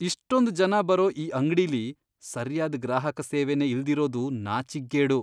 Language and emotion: Kannada, disgusted